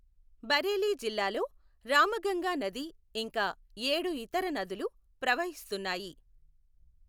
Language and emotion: Telugu, neutral